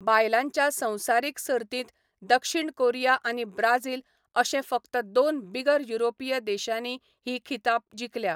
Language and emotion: Goan Konkani, neutral